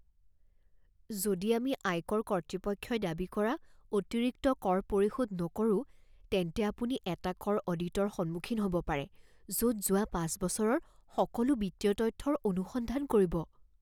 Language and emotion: Assamese, fearful